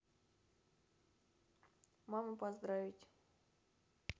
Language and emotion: Russian, neutral